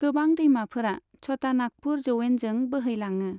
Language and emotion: Bodo, neutral